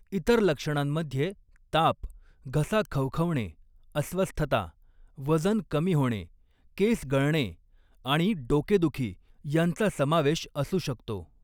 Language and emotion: Marathi, neutral